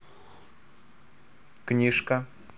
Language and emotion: Russian, neutral